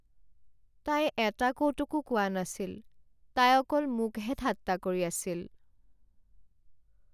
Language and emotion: Assamese, sad